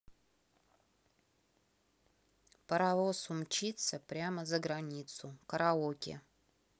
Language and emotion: Russian, neutral